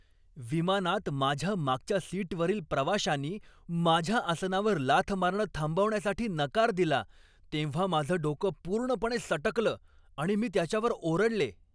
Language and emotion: Marathi, angry